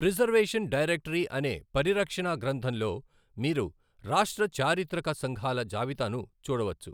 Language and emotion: Telugu, neutral